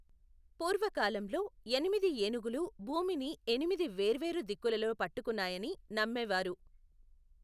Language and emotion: Telugu, neutral